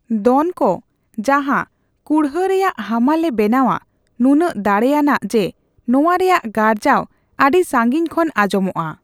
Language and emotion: Santali, neutral